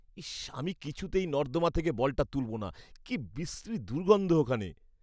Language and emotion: Bengali, disgusted